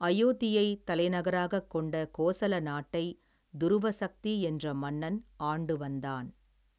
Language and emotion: Tamil, neutral